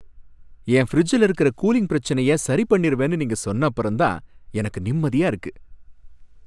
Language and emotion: Tamil, happy